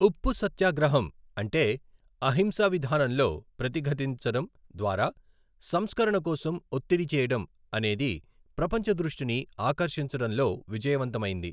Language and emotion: Telugu, neutral